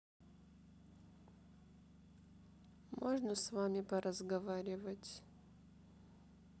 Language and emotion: Russian, sad